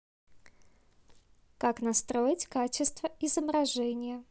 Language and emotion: Russian, neutral